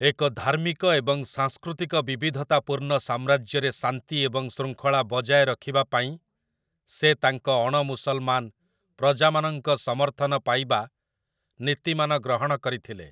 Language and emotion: Odia, neutral